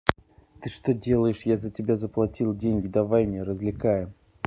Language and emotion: Russian, angry